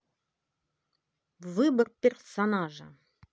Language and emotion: Russian, positive